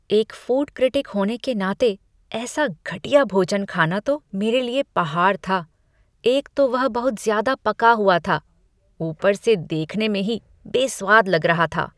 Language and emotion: Hindi, disgusted